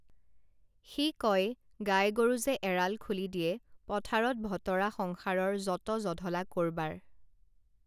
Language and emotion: Assamese, neutral